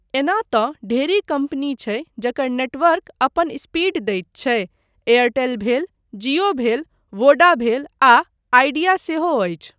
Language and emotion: Maithili, neutral